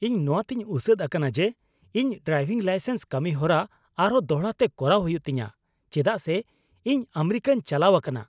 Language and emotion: Santali, angry